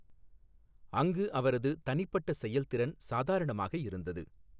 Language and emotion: Tamil, neutral